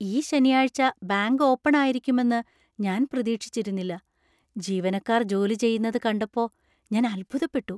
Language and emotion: Malayalam, surprised